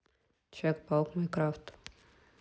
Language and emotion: Russian, neutral